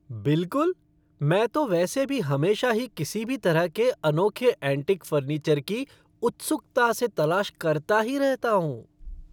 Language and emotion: Hindi, happy